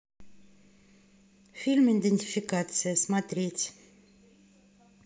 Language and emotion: Russian, neutral